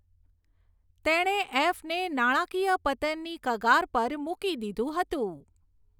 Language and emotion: Gujarati, neutral